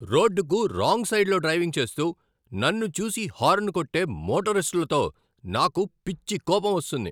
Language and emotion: Telugu, angry